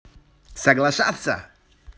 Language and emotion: Russian, positive